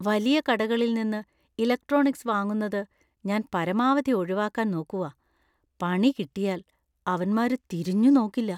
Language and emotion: Malayalam, fearful